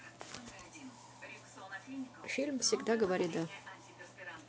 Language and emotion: Russian, neutral